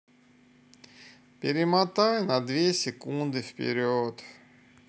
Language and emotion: Russian, sad